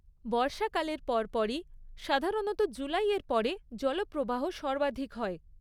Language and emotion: Bengali, neutral